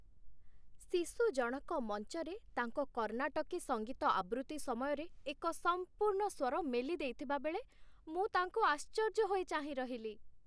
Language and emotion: Odia, happy